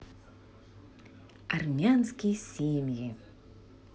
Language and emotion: Russian, positive